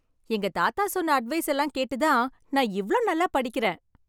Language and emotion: Tamil, happy